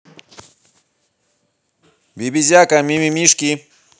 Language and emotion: Russian, positive